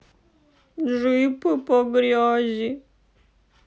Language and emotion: Russian, sad